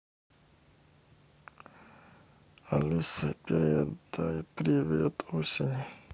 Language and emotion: Russian, sad